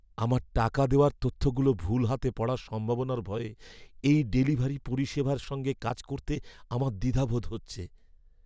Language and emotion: Bengali, fearful